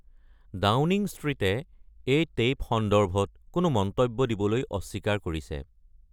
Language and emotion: Assamese, neutral